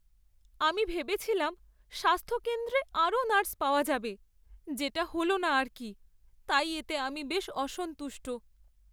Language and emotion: Bengali, sad